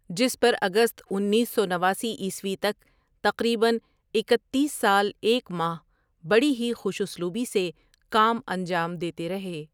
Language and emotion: Urdu, neutral